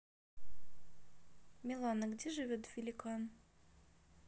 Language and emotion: Russian, neutral